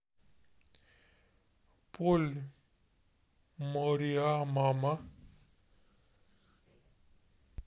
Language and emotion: Russian, neutral